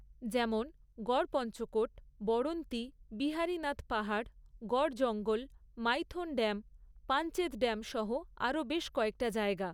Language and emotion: Bengali, neutral